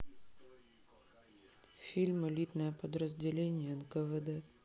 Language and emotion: Russian, neutral